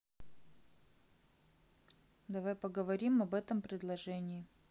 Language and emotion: Russian, neutral